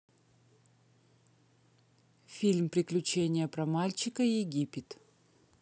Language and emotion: Russian, neutral